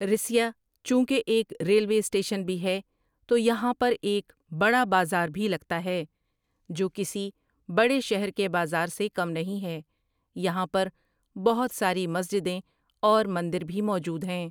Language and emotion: Urdu, neutral